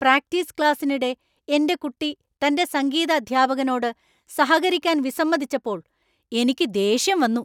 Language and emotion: Malayalam, angry